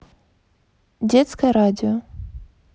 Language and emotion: Russian, neutral